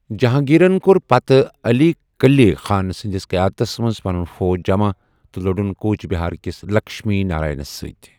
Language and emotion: Kashmiri, neutral